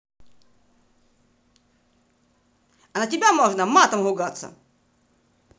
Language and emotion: Russian, angry